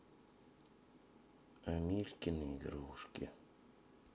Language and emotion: Russian, sad